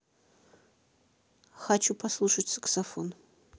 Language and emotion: Russian, neutral